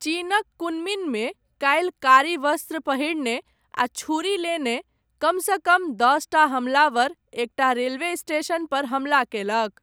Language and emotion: Maithili, neutral